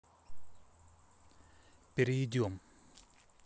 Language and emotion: Russian, neutral